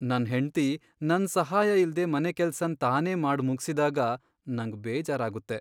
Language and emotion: Kannada, sad